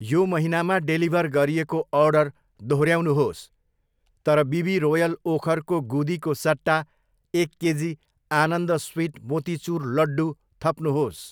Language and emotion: Nepali, neutral